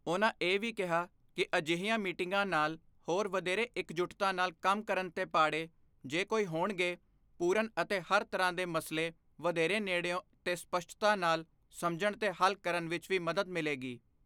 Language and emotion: Punjabi, neutral